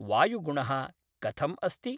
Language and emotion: Sanskrit, neutral